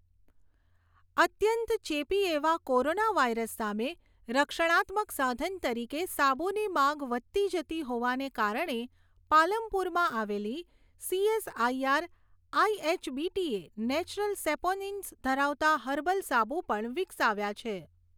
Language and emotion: Gujarati, neutral